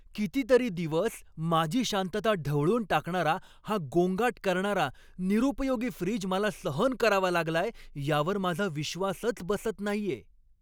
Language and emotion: Marathi, angry